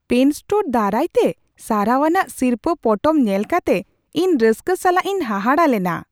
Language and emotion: Santali, surprised